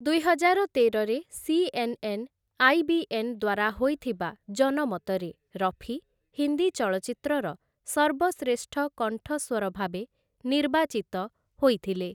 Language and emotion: Odia, neutral